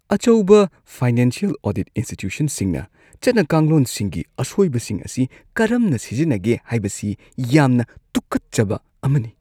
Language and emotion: Manipuri, disgusted